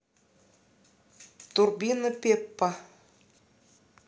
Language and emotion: Russian, neutral